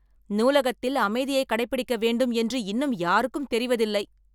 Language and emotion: Tamil, angry